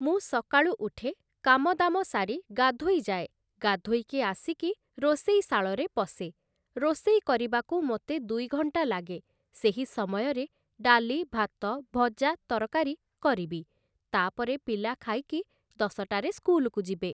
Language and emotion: Odia, neutral